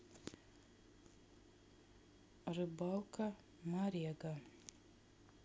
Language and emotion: Russian, neutral